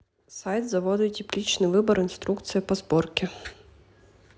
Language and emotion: Russian, neutral